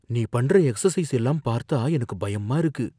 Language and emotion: Tamil, fearful